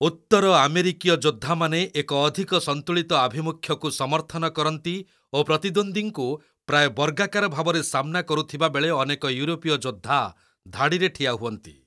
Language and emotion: Odia, neutral